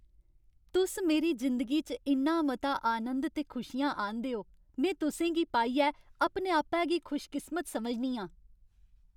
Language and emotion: Dogri, happy